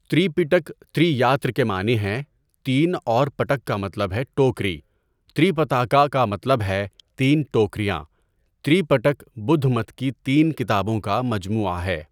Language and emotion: Urdu, neutral